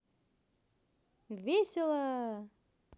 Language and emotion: Russian, positive